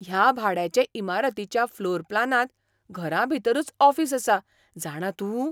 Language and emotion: Goan Konkani, surprised